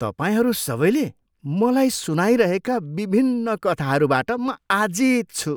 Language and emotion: Nepali, disgusted